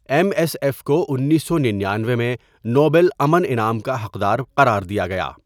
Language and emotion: Urdu, neutral